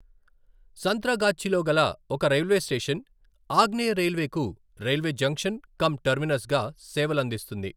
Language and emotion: Telugu, neutral